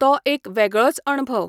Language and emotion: Goan Konkani, neutral